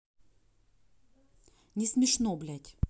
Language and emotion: Russian, angry